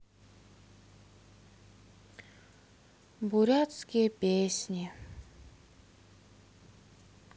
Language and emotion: Russian, sad